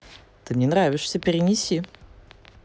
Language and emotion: Russian, positive